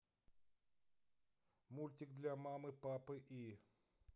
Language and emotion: Russian, neutral